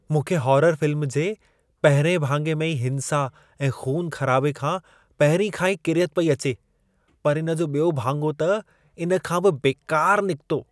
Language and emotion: Sindhi, disgusted